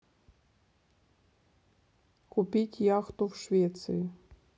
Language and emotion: Russian, neutral